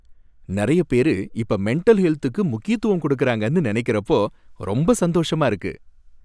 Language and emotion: Tamil, happy